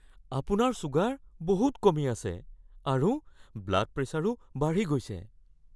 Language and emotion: Assamese, fearful